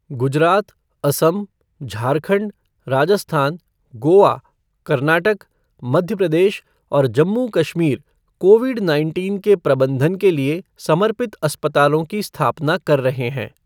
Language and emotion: Hindi, neutral